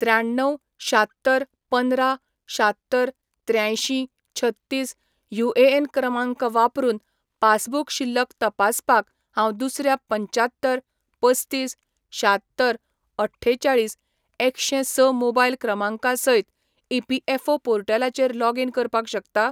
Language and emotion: Goan Konkani, neutral